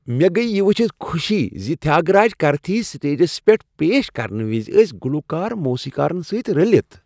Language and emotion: Kashmiri, happy